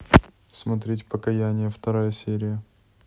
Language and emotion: Russian, neutral